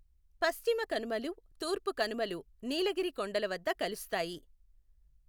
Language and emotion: Telugu, neutral